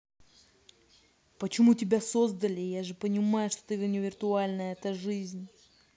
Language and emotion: Russian, angry